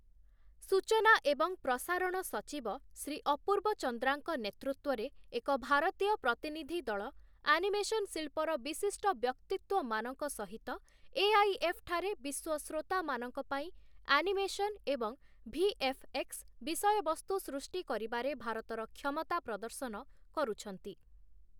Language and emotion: Odia, neutral